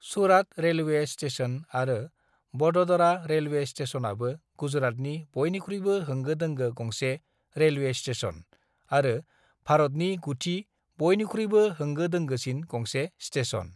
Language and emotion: Bodo, neutral